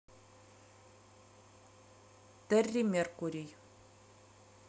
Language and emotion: Russian, neutral